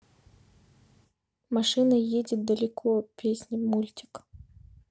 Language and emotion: Russian, neutral